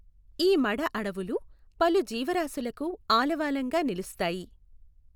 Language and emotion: Telugu, neutral